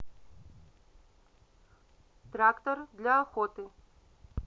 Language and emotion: Russian, neutral